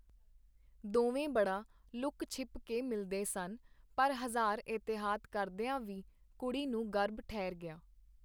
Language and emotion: Punjabi, neutral